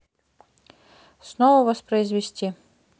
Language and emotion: Russian, neutral